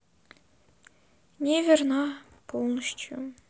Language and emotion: Russian, sad